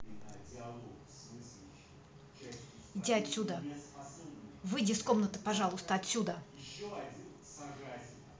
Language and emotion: Russian, angry